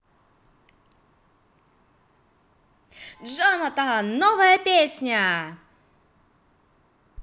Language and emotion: Russian, positive